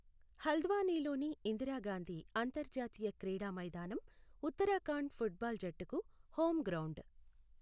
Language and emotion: Telugu, neutral